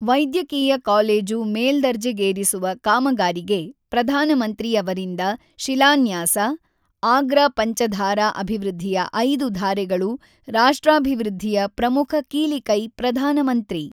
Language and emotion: Kannada, neutral